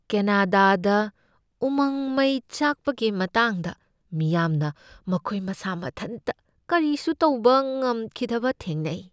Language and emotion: Manipuri, fearful